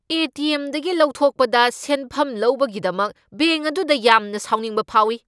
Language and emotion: Manipuri, angry